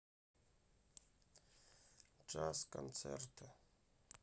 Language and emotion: Russian, sad